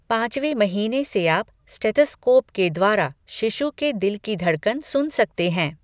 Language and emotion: Hindi, neutral